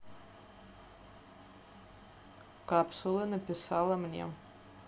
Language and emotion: Russian, neutral